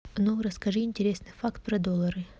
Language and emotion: Russian, neutral